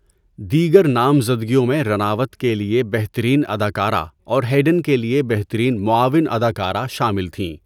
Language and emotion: Urdu, neutral